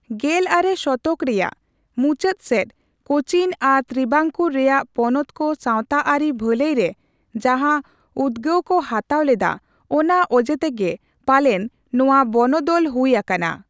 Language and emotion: Santali, neutral